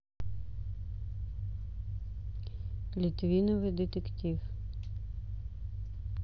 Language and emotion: Russian, neutral